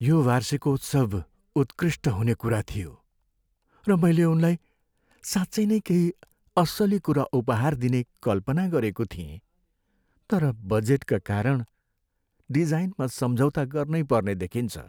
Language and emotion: Nepali, sad